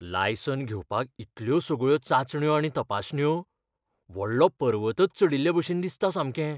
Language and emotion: Goan Konkani, fearful